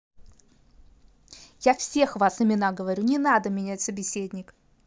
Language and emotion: Russian, angry